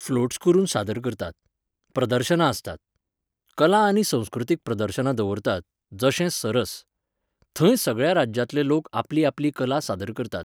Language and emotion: Goan Konkani, neutral